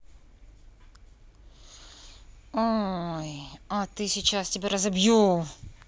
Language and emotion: Russian, angry